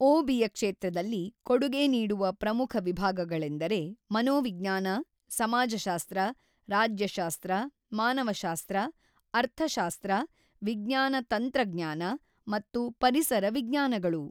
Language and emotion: Kannada, neutral